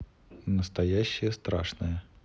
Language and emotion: Russian, neutral